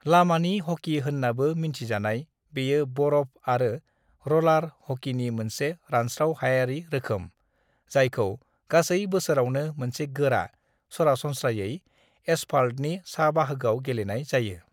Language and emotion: Bodo, neutral